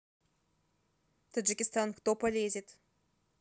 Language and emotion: Russian, neutral